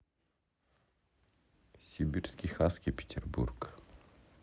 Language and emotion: Russian, neutral